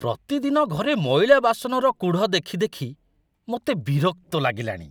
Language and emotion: Odia, disgusted